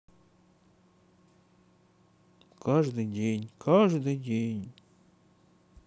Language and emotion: Russian, sad